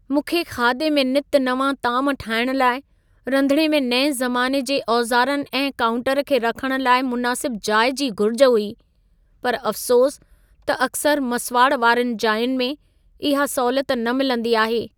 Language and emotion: Sindhi, sad